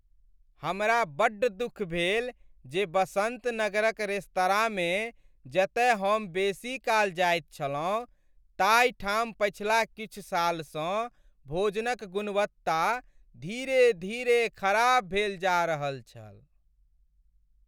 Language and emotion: Maithili, sad